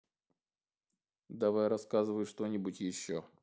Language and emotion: Russian, neutral